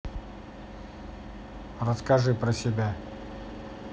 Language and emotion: Russian, neutral